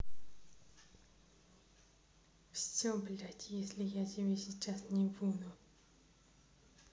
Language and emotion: Russian, neutral